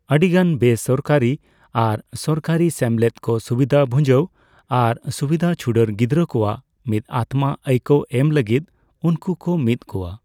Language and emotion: Santali, neutral